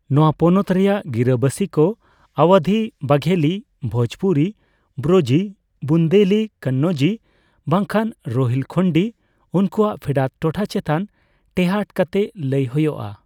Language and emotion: Santali, neutral